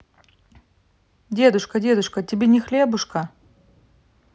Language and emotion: Russian, neutral